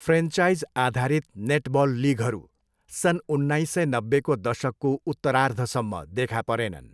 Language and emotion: Nepali, neutral